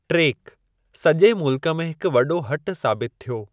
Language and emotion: Sindhi, neutral